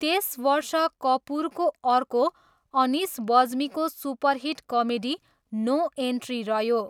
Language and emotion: Nepali, neutral